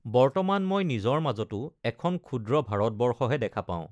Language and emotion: Assamese, neutral